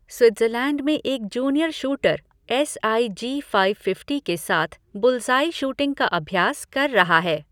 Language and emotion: Hindi, neutral